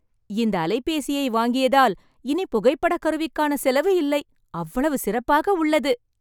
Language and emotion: Tamil, happy